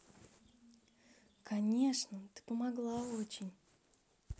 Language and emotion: Russian, positive